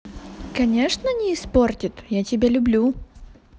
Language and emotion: Russian, positive